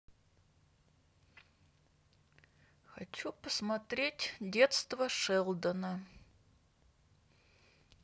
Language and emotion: Russian, neutral